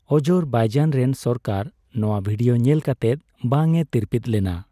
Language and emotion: Santali, neutral